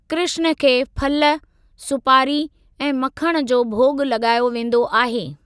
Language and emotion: Sindhi, neutral